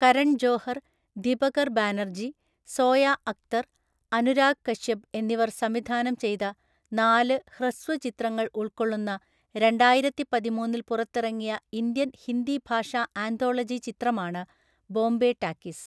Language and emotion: Malayalam, neutral